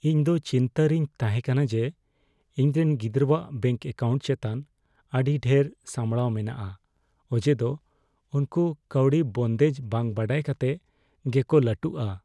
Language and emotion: Santali, fearful